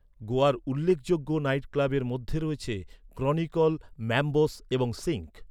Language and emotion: Bengali, neutral